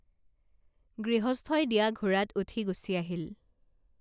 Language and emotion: Assamese, neutral